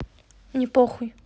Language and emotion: Russian, angry